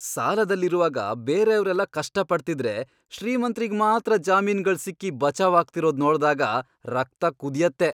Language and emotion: Kannada, angry